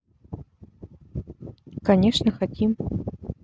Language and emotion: Russian, neutral